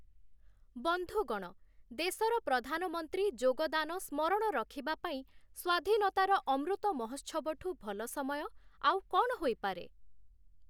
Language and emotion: Odia, neutral